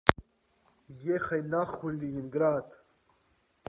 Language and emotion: Russian, neutral